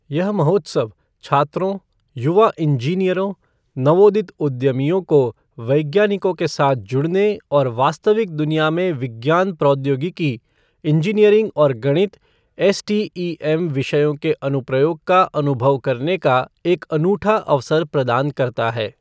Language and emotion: Hindi, neutral